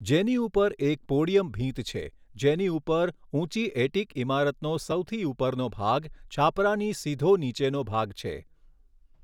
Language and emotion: Gujarati, neutral